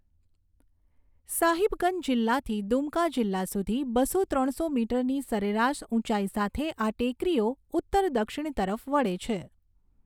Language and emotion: Gujarati, neutral